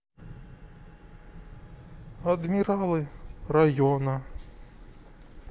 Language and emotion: Russian, sad